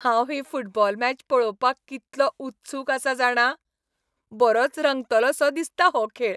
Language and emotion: Goan Konkani, happy